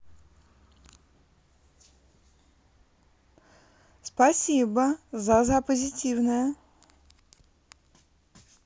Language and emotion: Russian, positive